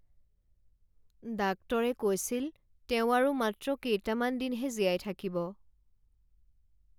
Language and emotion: Assamese, sad